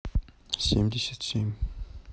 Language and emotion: Russian, neutral